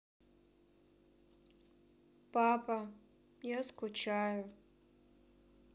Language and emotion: Russian, sad